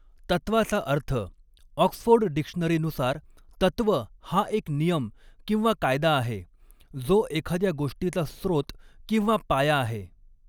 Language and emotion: Marathi, neutral